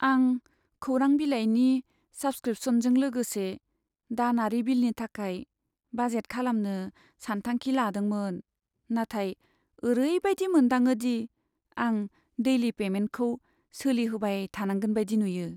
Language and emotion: Bodo, sad